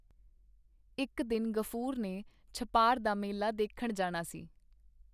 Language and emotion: Punjabi, neutral